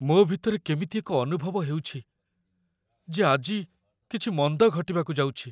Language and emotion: Odia, fearful